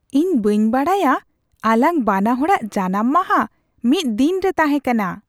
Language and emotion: Santali, surprised